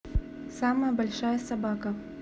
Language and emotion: Russian, neutral